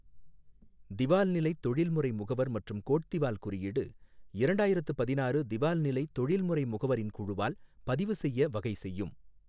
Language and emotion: Tamil, neutral